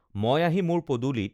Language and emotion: Assamese, neutral